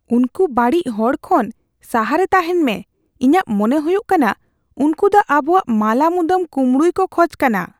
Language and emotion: Santali, fearful